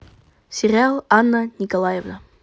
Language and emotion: Russian, positive